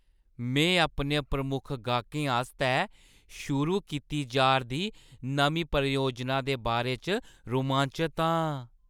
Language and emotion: Dogri, happy